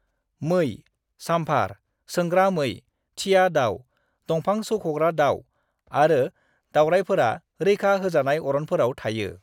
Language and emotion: Bodo, neutral